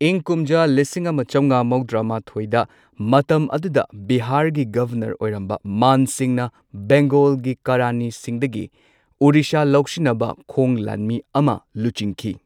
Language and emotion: Manipuri, neutral